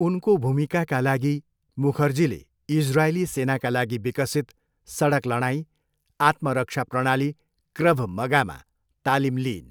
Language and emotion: Nepali, neutral